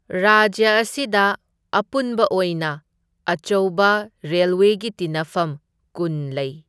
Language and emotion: Manipuri, neutral